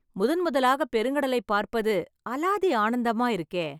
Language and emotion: Tamil, happy